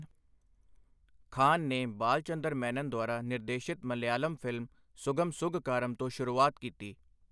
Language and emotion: Punjabi, neutral